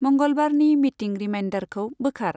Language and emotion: Bodo, neutral